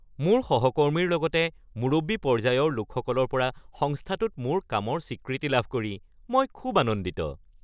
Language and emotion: Assamese, happy